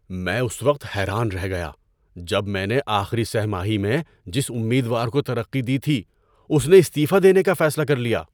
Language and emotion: Urdu, surprised